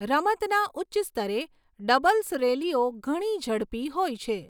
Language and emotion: Gujarati, neutral